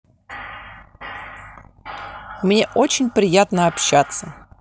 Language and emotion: Russian, neutral